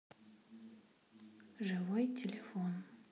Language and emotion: Russian, neutral